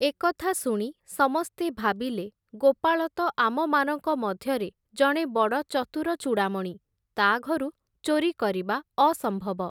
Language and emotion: Odia, neutral